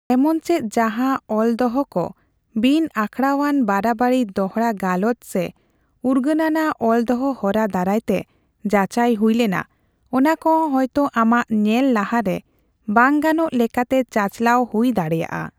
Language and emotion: Santali, neutral